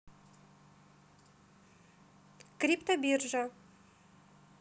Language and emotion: Russian, neutral